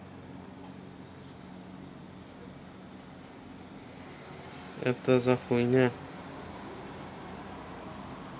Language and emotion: Russian, neutral